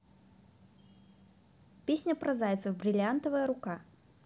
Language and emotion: Russian, positive